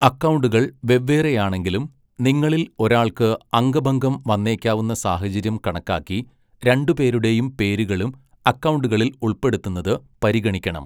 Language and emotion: Malayalam, neutral